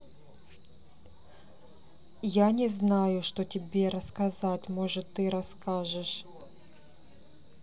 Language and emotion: Russian, neutral